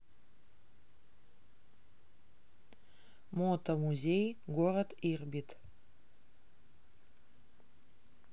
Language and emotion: Russian, neutral